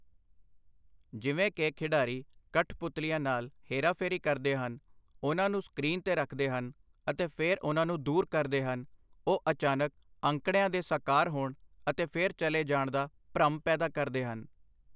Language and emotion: Punjabi, neutral